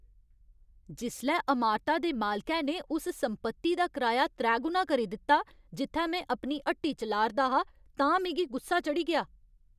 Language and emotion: Dogri, angry